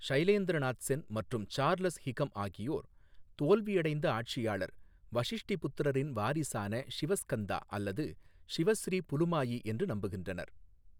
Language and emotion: Tamil, neutral